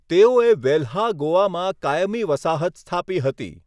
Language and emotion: Gujarati, neutral